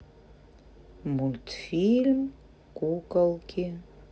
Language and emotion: Russian, neutral